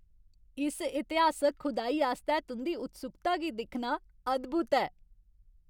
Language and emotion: Dogri, happy